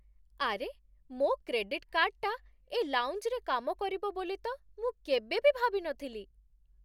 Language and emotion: Odia, surprised